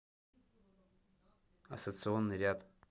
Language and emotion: Russian, neutral